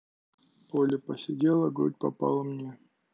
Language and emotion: Russian, sad